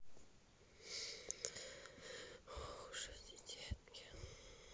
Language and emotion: Russian, sad